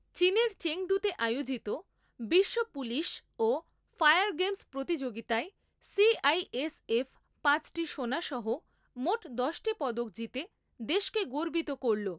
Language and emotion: Bengali, neutral